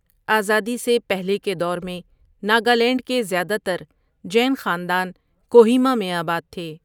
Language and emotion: Urdu, neutral